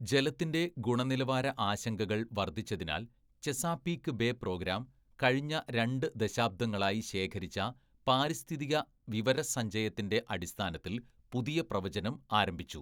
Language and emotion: Malayalam, neutral